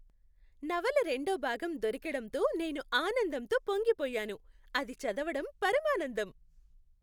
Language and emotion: Telugu, happy